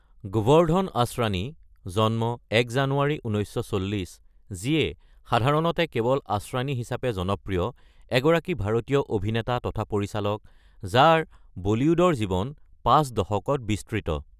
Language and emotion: Assamese, neutral